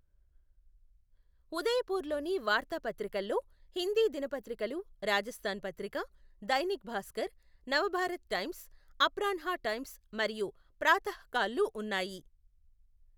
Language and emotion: Telugu, neutral